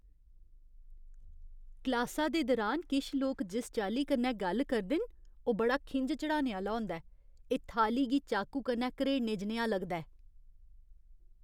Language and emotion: Dogri, disgusted